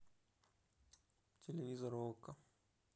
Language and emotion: Russian, neutral